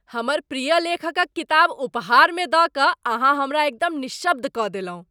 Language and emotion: Maithili, surprised